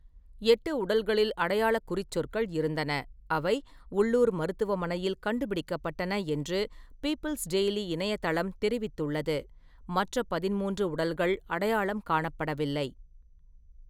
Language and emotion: Tamil, neutral